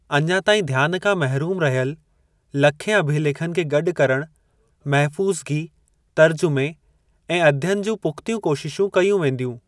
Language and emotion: Sindhi, neutral